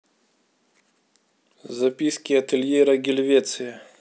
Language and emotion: Russian, neutral